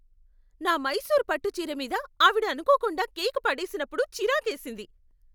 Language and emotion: Telugu, angry